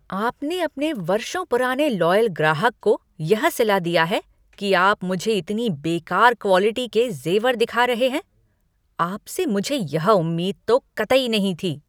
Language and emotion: Hindi, angry